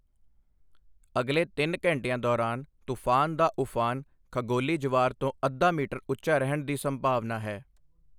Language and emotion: Punjabi, neutral